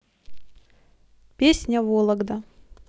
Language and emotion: Russian, positive